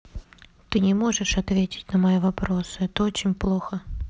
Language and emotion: Russian, sad